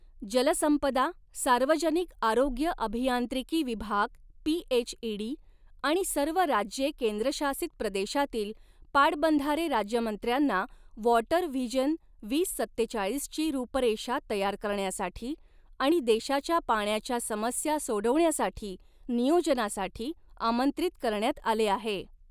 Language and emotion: Marathi, neutral